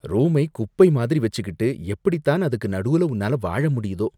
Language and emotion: Tamil, disgusted